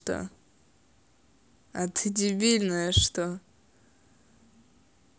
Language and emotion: Russian, neutral